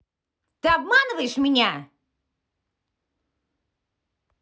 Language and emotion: Russian, angry